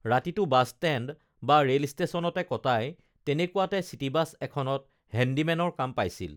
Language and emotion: Assamese, neutral